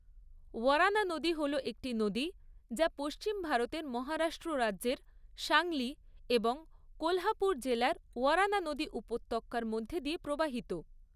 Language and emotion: Bengali, neutral